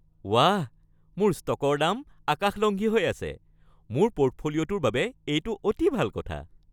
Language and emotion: Assamese, happy